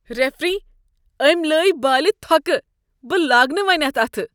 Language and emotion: Kashmiri, disgusted